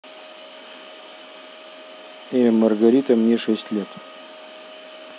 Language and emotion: Russian, neutral